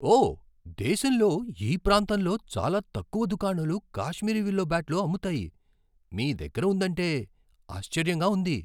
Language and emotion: Telugu, surprised